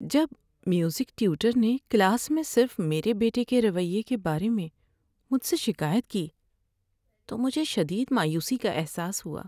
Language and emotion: Urdu, sad